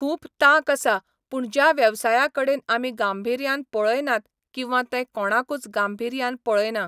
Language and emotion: Goan Konkani, neutral